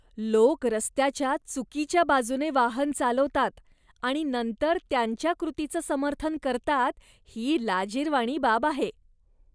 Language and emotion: Marathi, disgusted